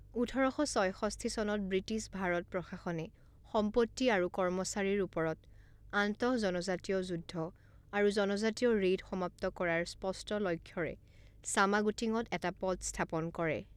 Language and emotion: Assamese, neutral